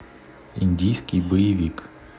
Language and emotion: Russian, neutral